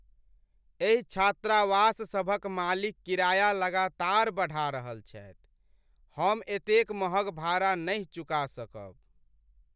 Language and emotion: Maithili, sad